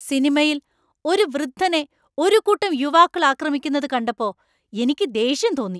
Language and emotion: Malayalam, angry